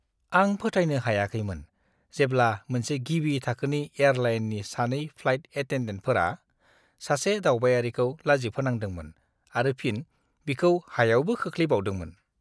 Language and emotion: Bodo, disgusted